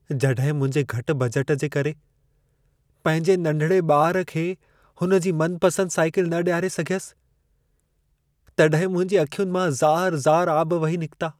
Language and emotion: Sindhi, sad